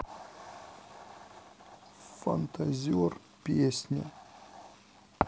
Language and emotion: Russian, sad